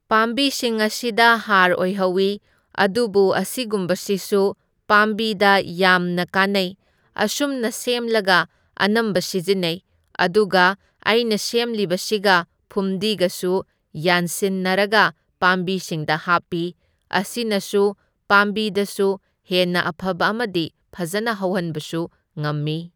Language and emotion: Manipuri, neutral